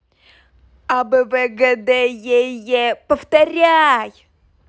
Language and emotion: Russian, angry